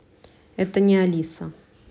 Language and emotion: Russian, neutral